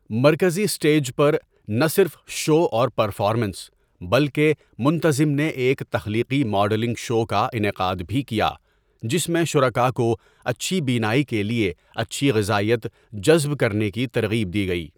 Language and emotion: Urdu, neutral